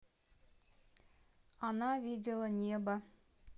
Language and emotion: Russian, neutral